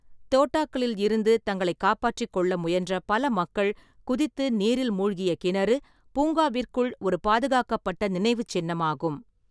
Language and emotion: Tamil, neutral